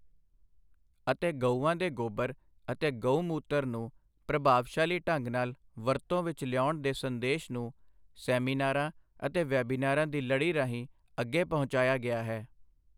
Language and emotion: Punjabi, neutral